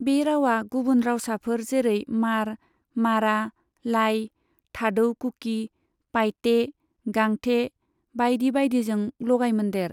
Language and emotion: Bodo, neutral